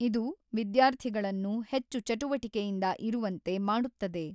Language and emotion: Kannada, neutral